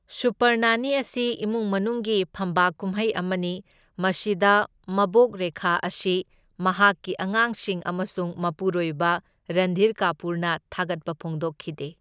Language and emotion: Manipuri, neutral